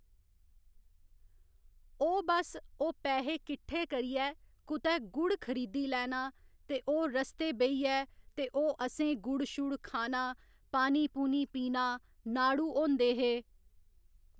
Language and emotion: Dogri, neutral